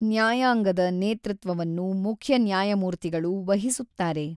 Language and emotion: Kannada, neutral